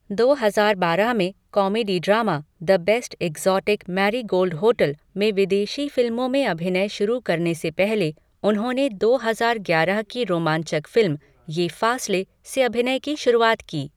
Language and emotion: Hindi, neutral